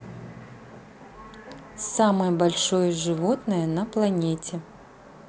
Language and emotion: Russian, neutral